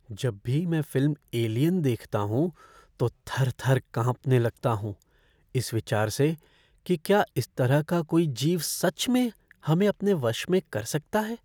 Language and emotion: Hindi, fearful